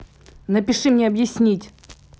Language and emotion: Russian, angry